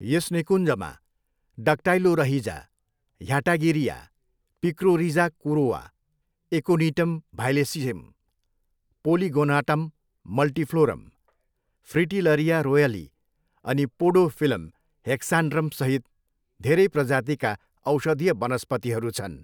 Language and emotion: Nepali, neutral